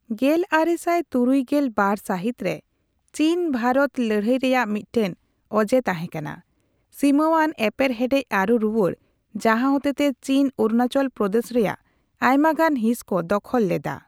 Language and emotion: Santali, neutral